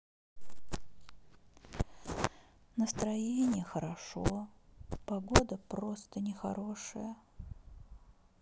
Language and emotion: Russian, sad